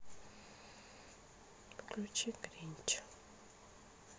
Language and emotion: Russian, sad